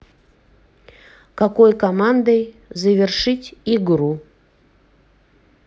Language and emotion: Russian, neutral